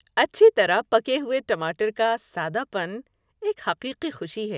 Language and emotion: Urdu, happy